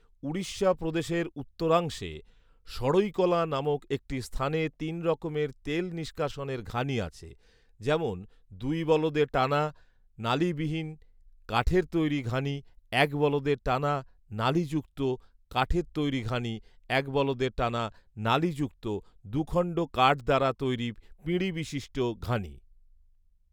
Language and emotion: Bengali, neutral